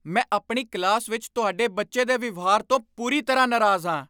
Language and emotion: Punjabi, angry